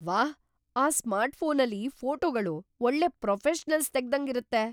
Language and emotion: Kannada, surprised